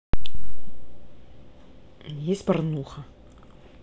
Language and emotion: Russian, neutral